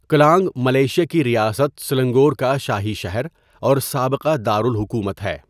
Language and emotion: Urdu, neutral